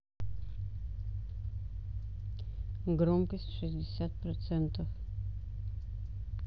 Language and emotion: Russian, neutral